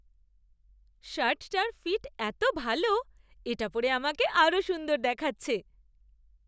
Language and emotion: Bengali, happy